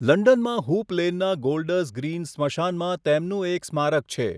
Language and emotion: Gujarati, neutral